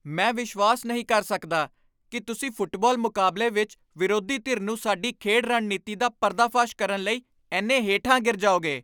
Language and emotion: Punjabi, angry